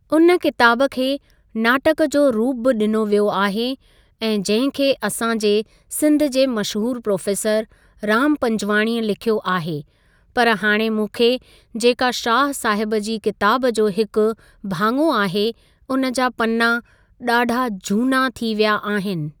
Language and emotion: Sindhi, neutral